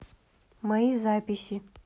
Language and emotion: Russian, neutral